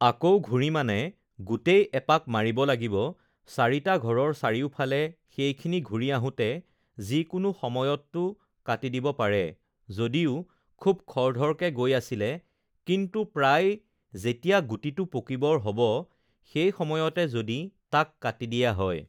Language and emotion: Assamese, neutral